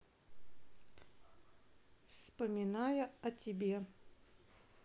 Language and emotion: Russian, neutral